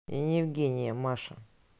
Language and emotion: Russian, neutral